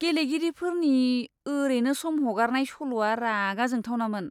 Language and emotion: Bodo, disgusted